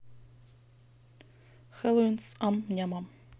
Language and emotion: Russian, neutral